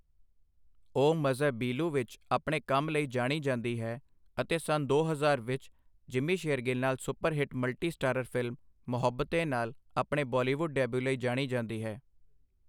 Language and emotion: Punjabi, neutral